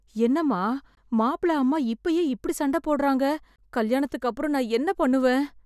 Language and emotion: Tamil, fearful